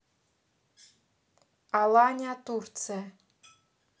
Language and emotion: Russian, neutral